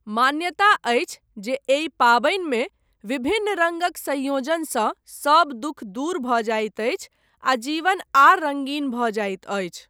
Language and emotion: Maithili, neutral